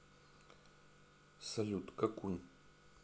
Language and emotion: Russian, neutral